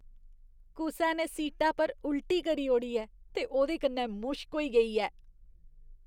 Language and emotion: Dogri, disgusted